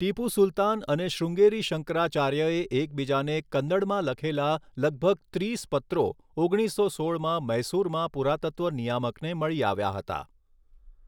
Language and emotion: Gujarati, neutral